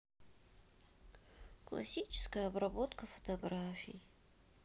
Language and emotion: Russian, sad